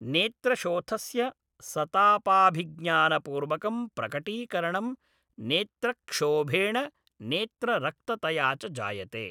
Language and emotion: Sanskrit, neutral